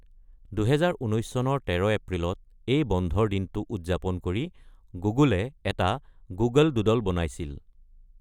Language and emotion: Assamese, neutral